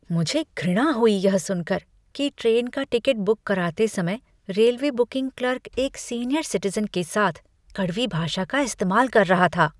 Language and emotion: Hindi, disgusted